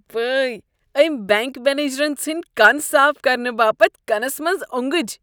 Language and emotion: Kashmiri, disgusted